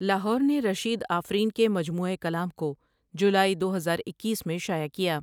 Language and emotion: Urdu, neutral